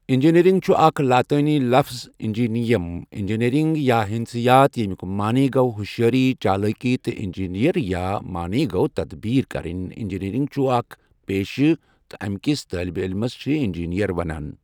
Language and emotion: Kashmiri, neutral